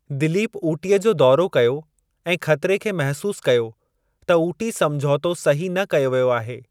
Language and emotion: Sindhi, neutral